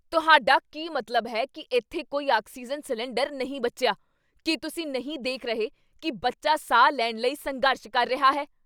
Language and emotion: Punjabi, angry